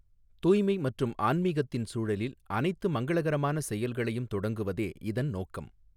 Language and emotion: Tamil, neutral